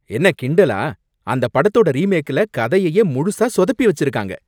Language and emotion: Tamil, angry